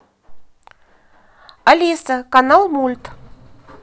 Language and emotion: Russian, positive